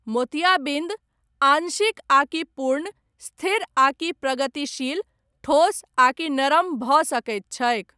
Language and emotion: Maithili, neutral